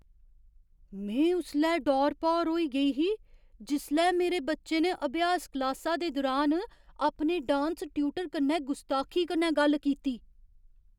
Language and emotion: Dogri, surprised